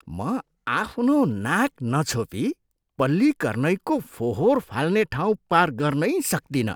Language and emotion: Nepali, disgusted